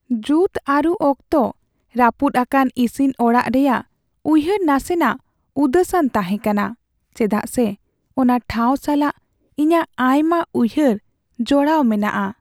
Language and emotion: Santali, sad